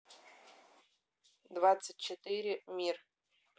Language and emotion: Russian, neutral